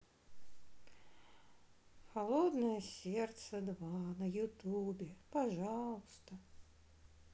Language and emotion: Russian, sad